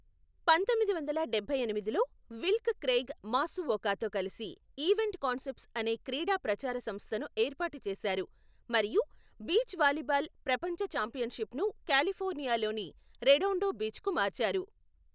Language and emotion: Telugu, neutral